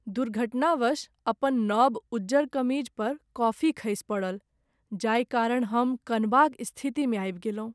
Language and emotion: Maithili, sad